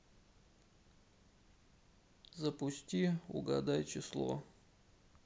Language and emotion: Russian, sad